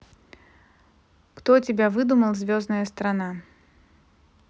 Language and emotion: Russian, neutral